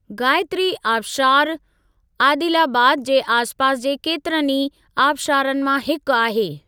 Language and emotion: Sindhi, neutral